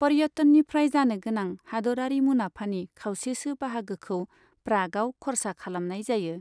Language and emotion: Bodo, neutral